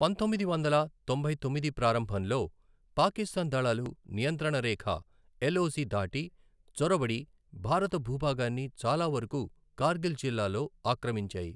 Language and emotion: Telugu, neutral